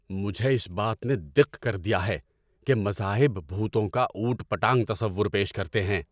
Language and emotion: Urdu, angry